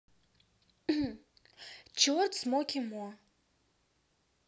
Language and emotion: Russian, neutral